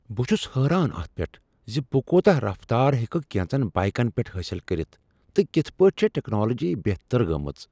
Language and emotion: Kashmiri, surprised